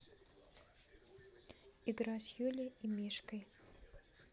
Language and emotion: Russian, neutral